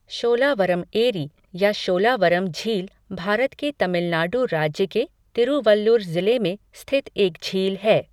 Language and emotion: Hindi, neutral